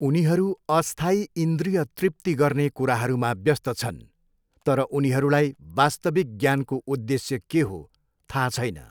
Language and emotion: Nepali, neutral